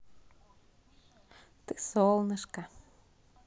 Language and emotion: Russian, positive